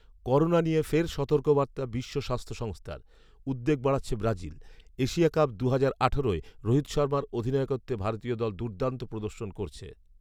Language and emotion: Bengali, neutral